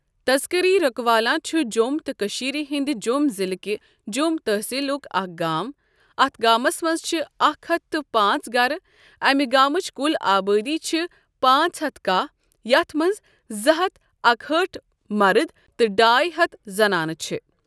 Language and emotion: Kashmiri, neutral